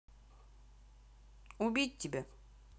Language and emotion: Russian, neutral